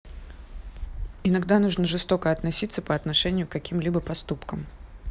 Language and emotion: Russian, neutral